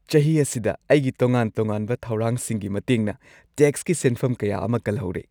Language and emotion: Manipuri, happy